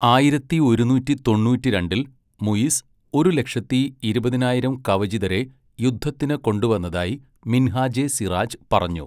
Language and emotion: Malayalam, neutral